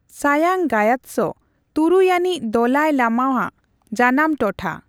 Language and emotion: Santali, neutral